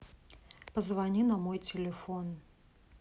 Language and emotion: Russian, neutral